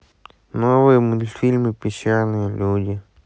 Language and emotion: Russian, sad